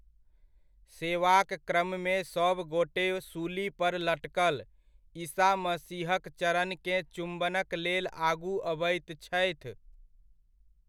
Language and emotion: Maithili, neutral